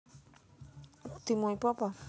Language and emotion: Russian, neutral